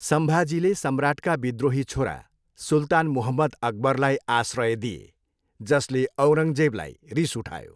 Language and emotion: Nepali, neutral